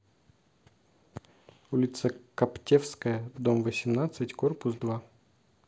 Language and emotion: Russian, neutral